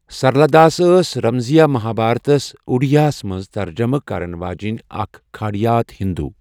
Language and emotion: Kashmiri, neutral